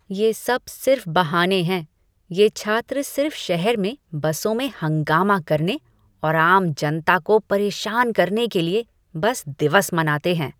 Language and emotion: Hindi, disgusted